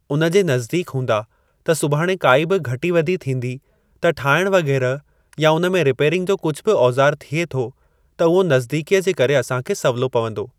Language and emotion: Sindhi, neutral